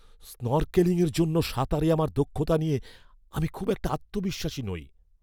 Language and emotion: Bengali, fearful